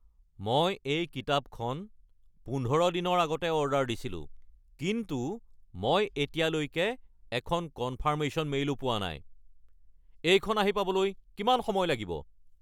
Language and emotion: Assamese, angry